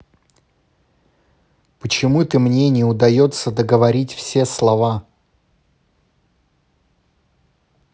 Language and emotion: Russian, neutral